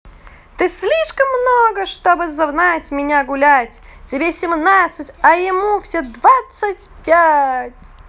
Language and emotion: Russian, positive